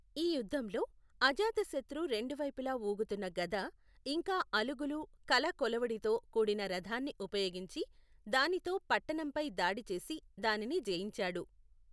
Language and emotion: Telugu, neutral